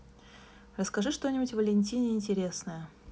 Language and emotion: Russian, neutral